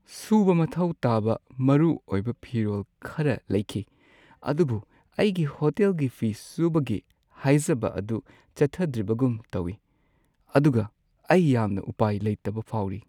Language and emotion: Manipuri, sad